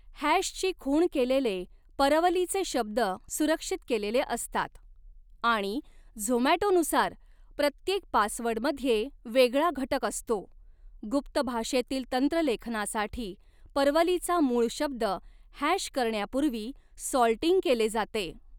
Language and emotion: Marathi, neutral